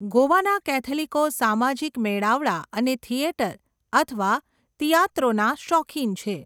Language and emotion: Gujarati, neutral